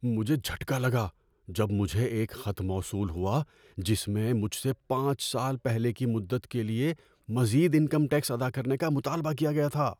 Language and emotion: Urdu, fearful